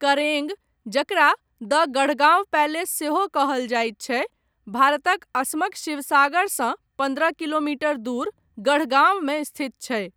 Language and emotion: Maithili, neutral